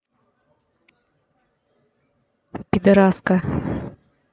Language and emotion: Russian, angry